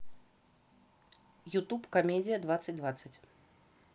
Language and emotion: Russian, neutral